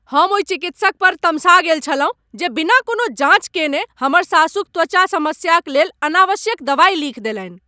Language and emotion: Maithili, angry